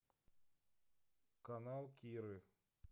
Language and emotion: Russian, neutral